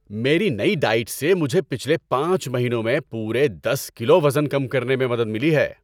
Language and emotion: Urdu, happy